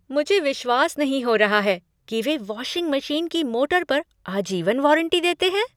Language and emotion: Hindi, surprised